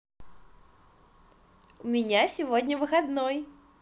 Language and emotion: Russian, positive